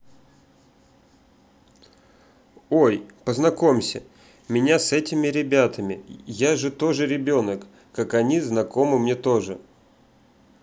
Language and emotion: Russian, neutral